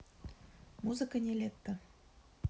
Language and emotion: Russian, neutral